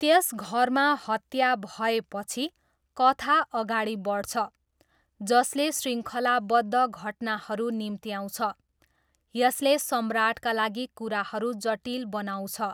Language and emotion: Nepali, neutral